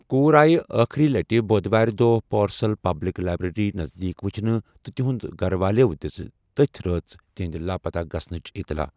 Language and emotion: Kashmiri, neutral